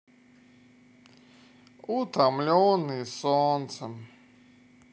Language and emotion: Russian, sad